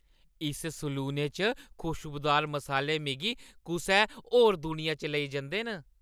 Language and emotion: Dogri, happy